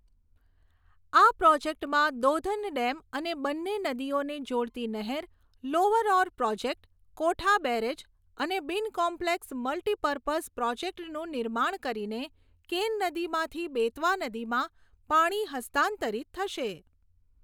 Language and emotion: Gujarati, neutral